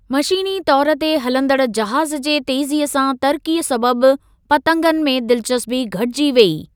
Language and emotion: Sindhi, neutral